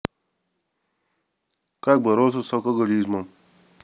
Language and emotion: Russian, neutral